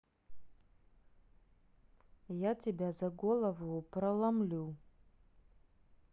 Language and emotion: Russian, neutral